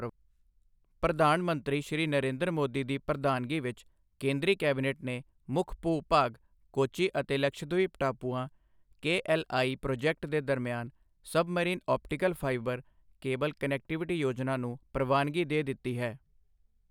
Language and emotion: Punjabi, neutral